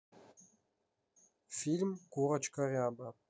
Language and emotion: Russian, neutral